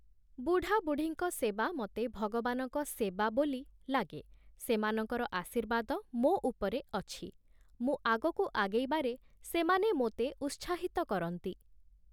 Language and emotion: Odia, neutral